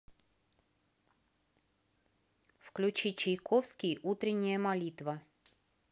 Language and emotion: Russian, neutral